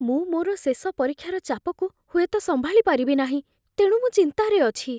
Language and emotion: Odia, fearful